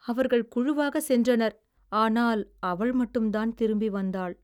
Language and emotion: Tamil, sad